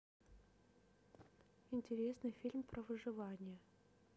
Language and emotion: Russian, neutral